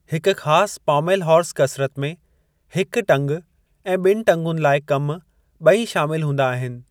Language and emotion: Sindhi, neutral